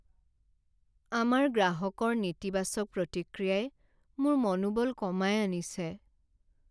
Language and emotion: Assamese, sad